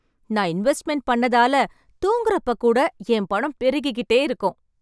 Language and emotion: Tamil, happy